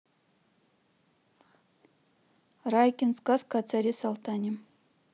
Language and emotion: Russian, neutral